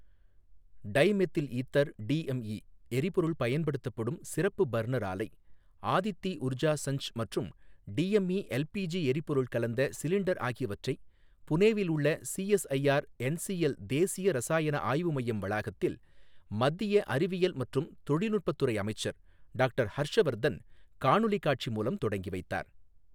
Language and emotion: Tamil, neutral